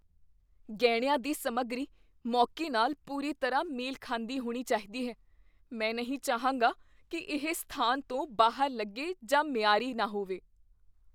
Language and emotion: Punjabi, fearful